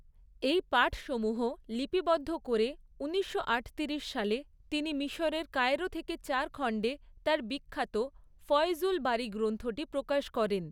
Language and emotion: Bengali, neutral